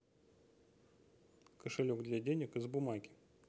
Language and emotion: Russian, neutral